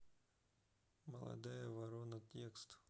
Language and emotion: Russian, neutral